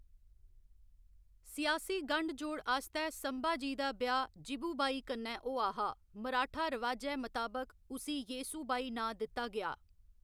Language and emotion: Dogri, neutral